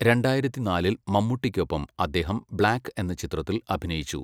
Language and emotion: Malayalam, neutral